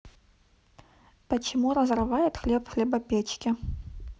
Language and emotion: Russian, neutral